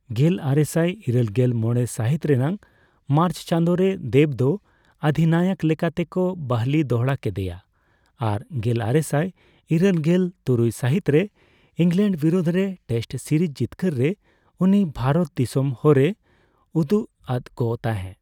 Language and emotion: Santali, neutral